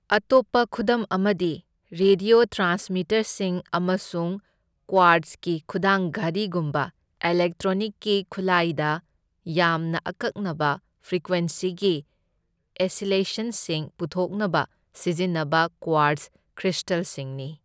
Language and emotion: Manipuri, neutral